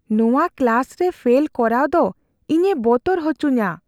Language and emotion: Santali, fearful